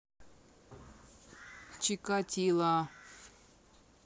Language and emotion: Russian, neutral